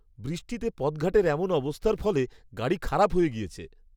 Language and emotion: Bengali, disgusted